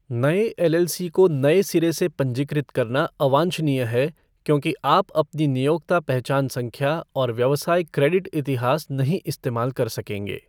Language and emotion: Hindi, neutral